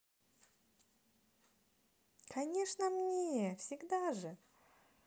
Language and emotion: Russian, positive